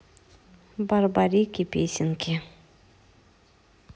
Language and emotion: Russian, neutral